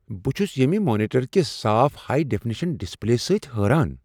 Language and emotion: Kashmiri, surprised